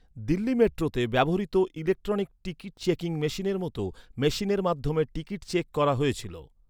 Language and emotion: Bengali, neutral